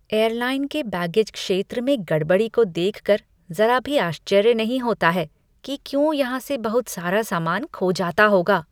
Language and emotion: Hindi, disgusted